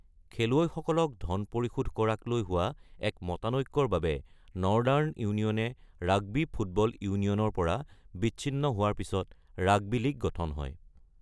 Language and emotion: Assamese, neutral